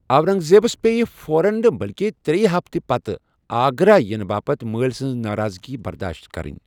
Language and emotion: Kashmiri, neutral